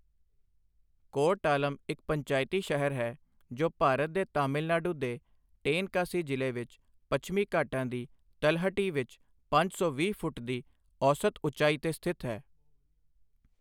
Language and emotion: Punjabi, neutral